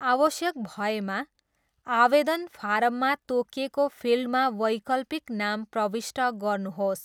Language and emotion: Nepali, neutral